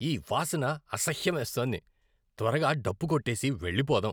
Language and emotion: Telugu, disgusted